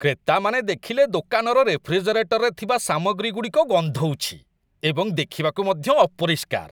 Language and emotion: Odia, disgusted